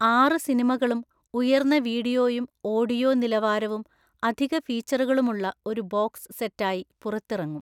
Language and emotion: Malayalam, neutral